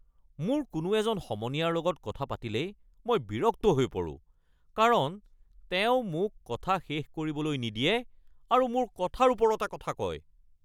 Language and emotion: Assamese, angry